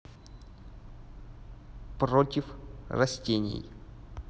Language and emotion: Russian, neutral